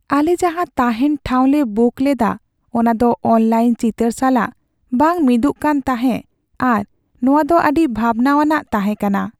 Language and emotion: Santali, sad